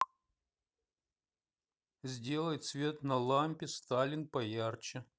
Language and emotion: Russian, neutral